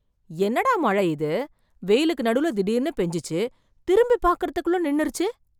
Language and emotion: Tamil, surprised